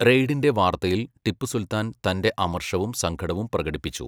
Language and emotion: Malayalam, neutral